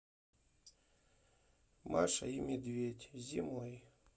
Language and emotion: Russian, sad